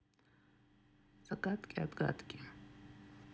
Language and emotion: Russian, sad